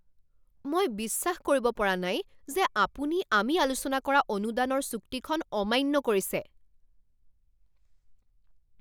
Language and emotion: Assamese, angry